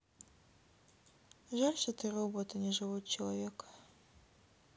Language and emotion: Russian, sad